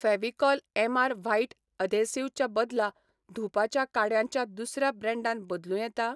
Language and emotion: Goan Konkani, neutral